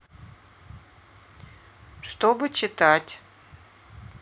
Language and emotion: Russian, neutral